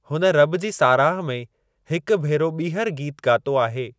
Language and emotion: Sindhi, neutral